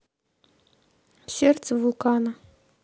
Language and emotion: Russian, neutral